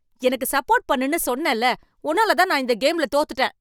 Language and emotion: Tamil, angry